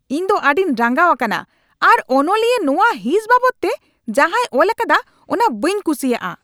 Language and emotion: Santali, angry